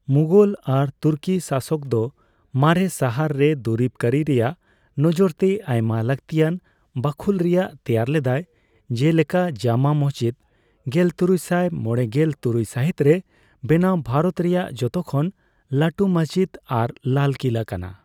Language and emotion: Santali, neutral